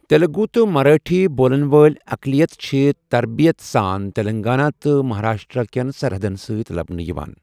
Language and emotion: Kashmiri, neutral